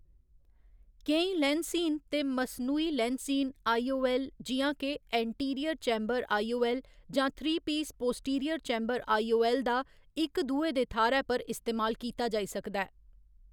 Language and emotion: Dogri, neutral